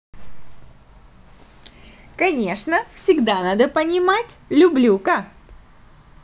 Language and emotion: Russian, positive